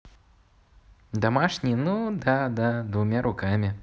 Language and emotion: Russian, positive